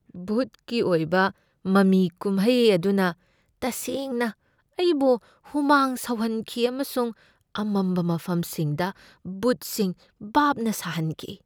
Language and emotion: Manipuri, fearful